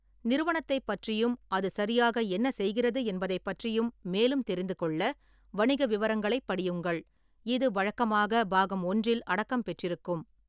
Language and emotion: Tamil, neutral